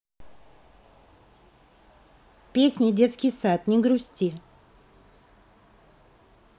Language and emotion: Russian, neutral